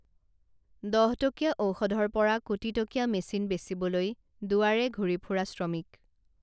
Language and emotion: Assamese, neutral